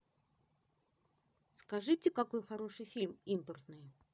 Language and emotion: Russian, positive